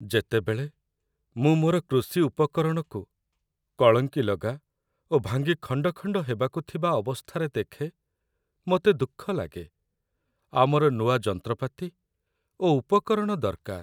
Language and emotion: Odia, sad